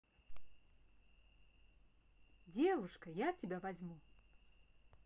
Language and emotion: Russian, positive